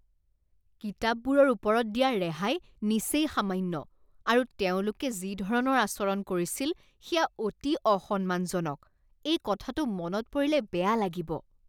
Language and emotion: Assamese, disgusted